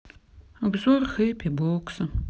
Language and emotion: Russian, sad